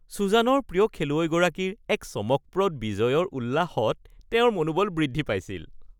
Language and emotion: Assamese, happy